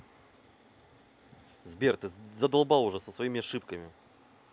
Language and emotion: Russian, angry